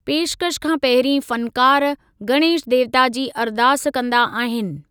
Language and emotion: Sindhi, neutral